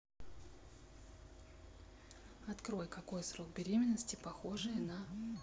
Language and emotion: Russian, neutral